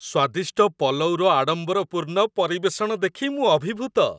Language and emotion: Odia, happy